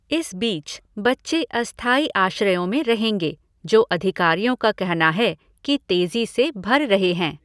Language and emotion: Hindi, neutral